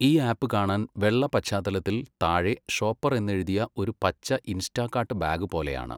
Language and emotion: Malayalam, neutral